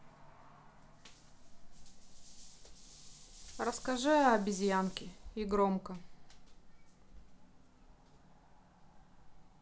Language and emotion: Russian, neutral